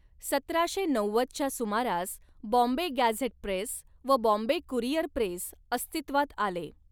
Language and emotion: Marathi, neutral